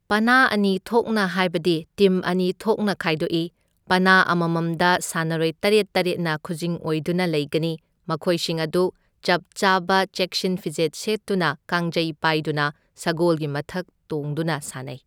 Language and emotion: Manipuri, neutral